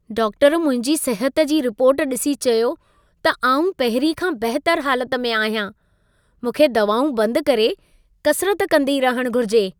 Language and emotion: Sindhi, happy